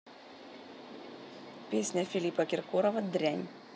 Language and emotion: Russian, neutral